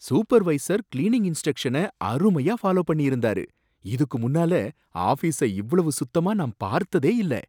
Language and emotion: Tamil, surprised